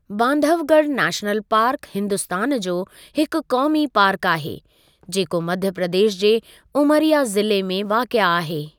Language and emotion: Sindhi, neutral